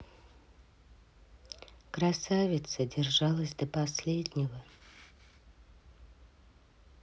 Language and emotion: Russian, neutral